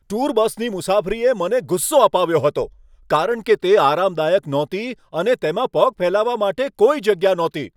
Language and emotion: Gujarati, angry